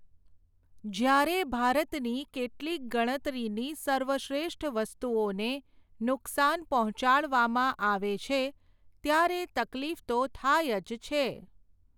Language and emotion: Gujarati, neutral